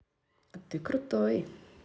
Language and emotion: Russian, positive